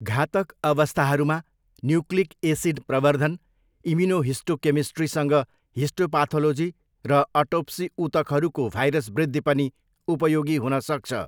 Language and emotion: Nepali, neutral